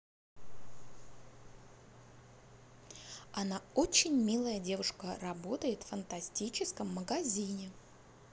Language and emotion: Russian, positive